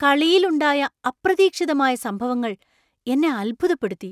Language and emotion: Malayalam, surprised